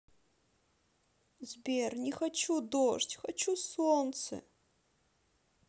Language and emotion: Russian, sad